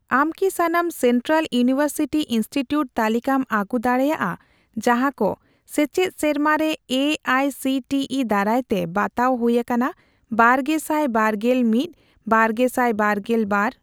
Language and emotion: Santali, neutral